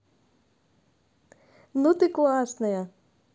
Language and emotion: Russian, positive